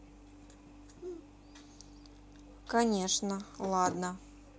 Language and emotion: Russian, neutral